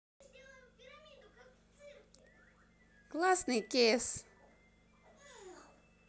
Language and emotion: Russian, positive